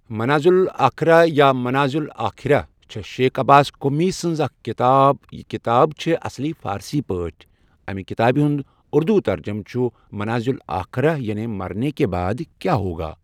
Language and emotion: Kashmiri, neutral